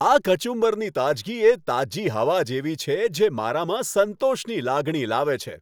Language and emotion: Gujarati, happy